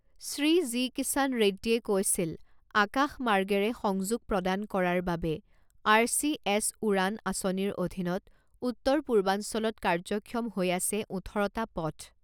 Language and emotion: Assamese, neutral